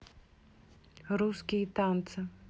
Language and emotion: Russian, neutral